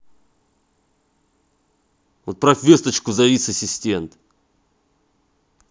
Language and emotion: Russian, angry